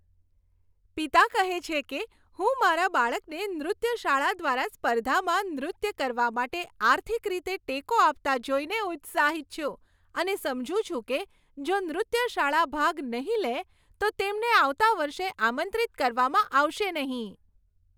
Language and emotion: Gujarati, happy